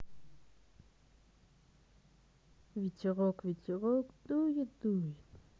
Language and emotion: Russian, neutral